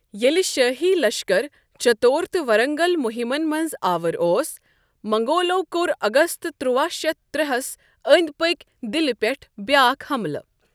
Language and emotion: Kashmiri, neutral